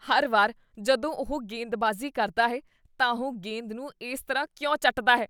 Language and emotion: Punjabi, disgusted